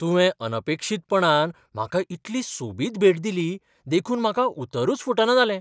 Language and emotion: Goan Konkani, surprised